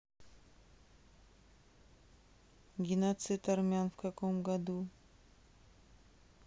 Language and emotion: Russian, neutral